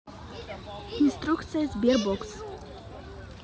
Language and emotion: Russian, neutral